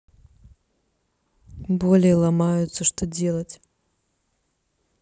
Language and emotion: Russian, neutral